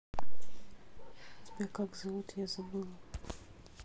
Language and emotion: Russian, neutral